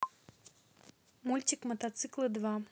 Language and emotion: Russian, neutral